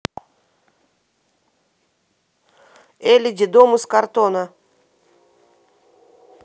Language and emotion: Russian, neutral